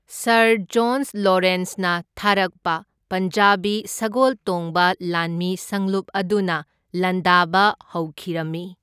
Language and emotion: Manipuri, neutral